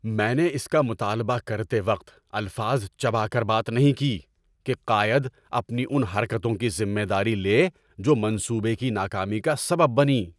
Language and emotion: Urdu, angry